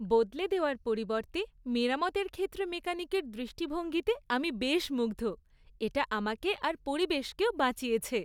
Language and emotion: Bengali, happy